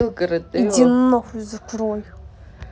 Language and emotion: Russian, angry